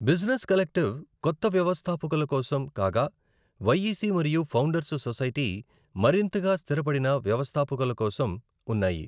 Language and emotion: Telugu, neutral